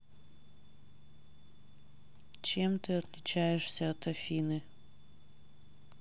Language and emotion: Russian, sad